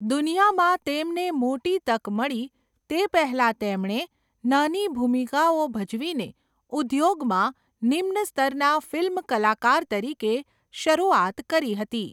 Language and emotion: Gujarati, neutral